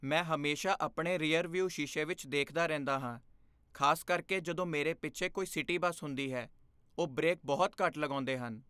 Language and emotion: Punjabi, fearful